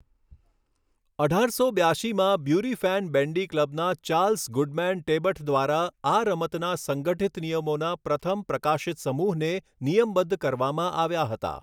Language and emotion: Gujarati, neutral